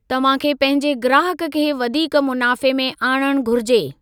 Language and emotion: Sindhi, neutral